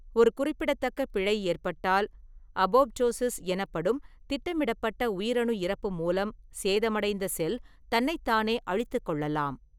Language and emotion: Tamil, neutral